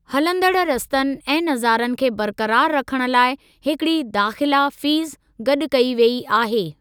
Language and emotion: Sindhi, neutral